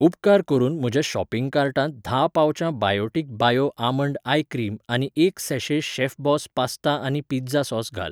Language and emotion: Goan Konkani, neutral